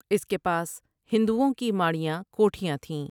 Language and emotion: Urdu, neutral